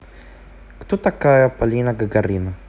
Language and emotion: Russian, neutral